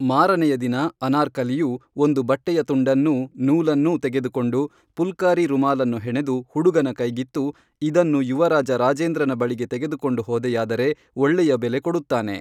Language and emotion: Kannada, neutral